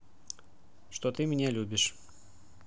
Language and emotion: Russian, neutral